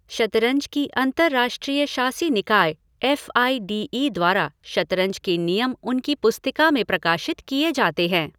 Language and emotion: Hindi, neutral